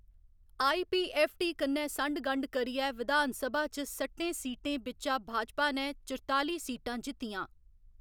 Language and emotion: Dogri, neutral